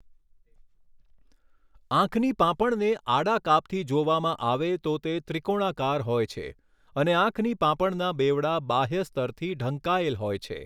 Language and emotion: Gujarati, neutral